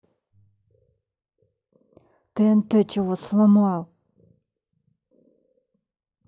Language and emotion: Russian, angry